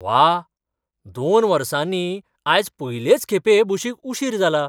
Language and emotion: Goan Konkani, surprised